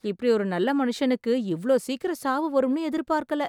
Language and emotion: Tamil, surprised